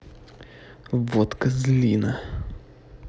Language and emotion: Russian, angry